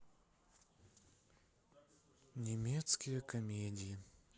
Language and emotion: Russian, sad